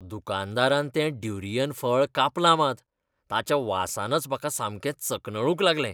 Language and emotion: Goan Konkani, disgusted